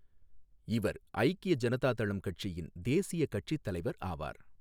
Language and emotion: Tamil, neutral